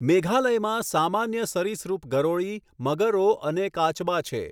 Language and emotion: Gujarati, neutral